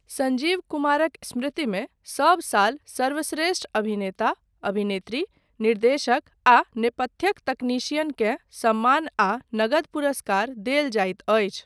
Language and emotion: Maithili, neutral